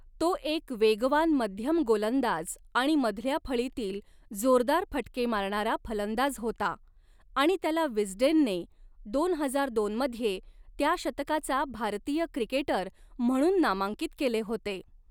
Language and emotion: Marathi, neutral